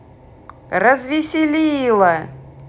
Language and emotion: Russian, positive